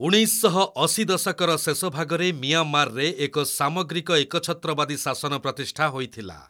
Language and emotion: Odia, neutral